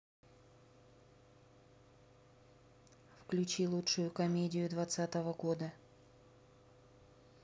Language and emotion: Russian, neutral